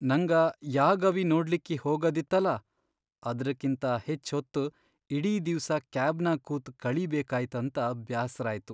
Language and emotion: Kannada, sad